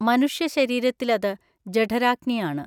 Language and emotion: Malayalam, neutral